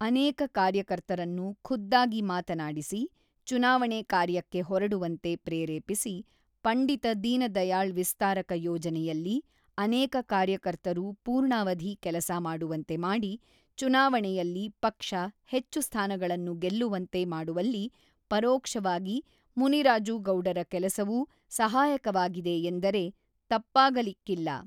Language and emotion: Kannada, neutral